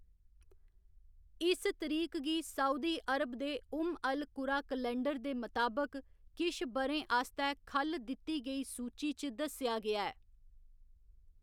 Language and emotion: Dogri, neutral